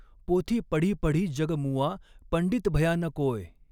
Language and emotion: Marathi, neutral